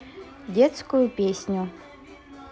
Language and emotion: Russian, neutral